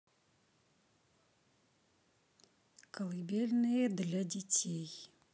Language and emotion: Russian, neutral